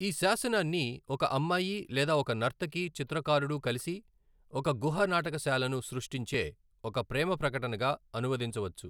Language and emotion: Telugu, neutral